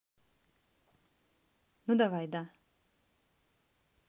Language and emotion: Russian, neutral